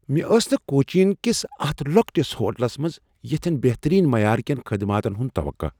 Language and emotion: Kashmiri, surprised